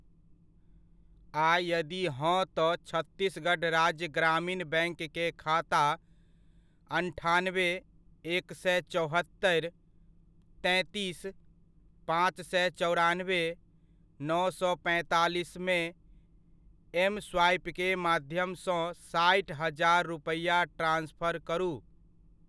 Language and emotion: Maithili, neutral